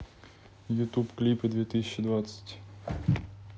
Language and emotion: Russian, neutral